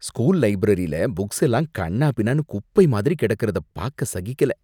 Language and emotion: Tamil, disgusted